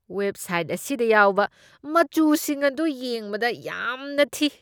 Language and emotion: Manipuri, disgusted